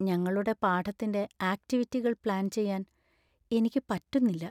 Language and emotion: Malayalam, sad